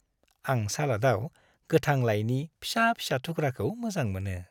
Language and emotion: Bodo, happy